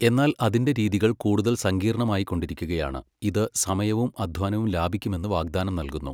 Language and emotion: Malayalam, neutral